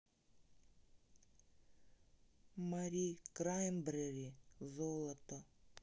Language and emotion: Russian, neutral